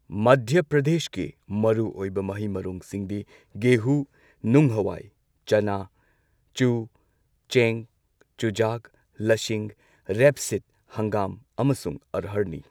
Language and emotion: Manipuri, neutral